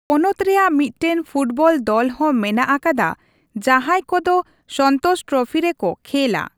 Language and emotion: Santali, neutral